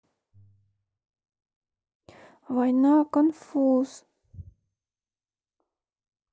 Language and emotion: Russian, sad